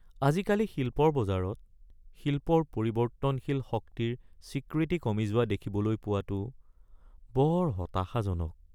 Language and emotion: Assamese, sad